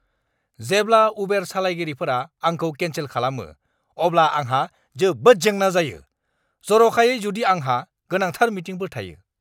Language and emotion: Bodo, angry